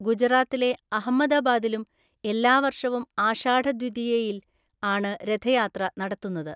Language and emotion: Malayalam, neutral